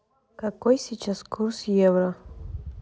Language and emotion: Russian, neutral